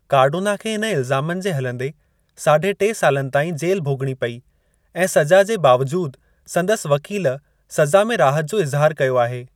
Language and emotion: Sindhi, neutral